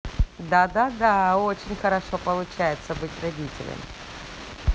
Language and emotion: Russian, positive